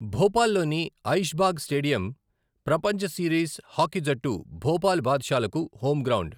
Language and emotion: Telugu, neutral